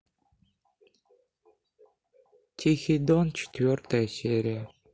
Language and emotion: Russian, sad